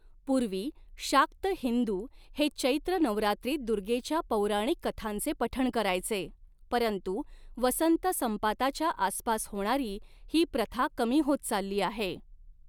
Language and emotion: Marathi, neutral